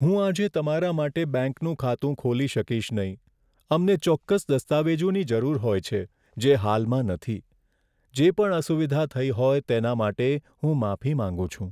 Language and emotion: Gujarati, sad